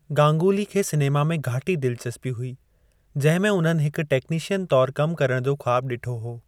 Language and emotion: Sindhi, neutral